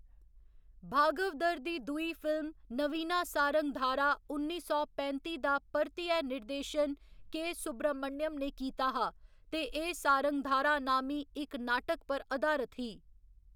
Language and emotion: Dogri, neutral